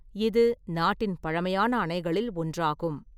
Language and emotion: Tamil, neutral